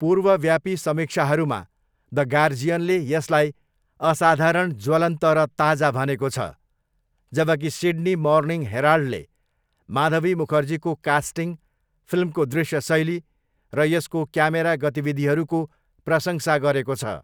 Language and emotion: Nepali, neutral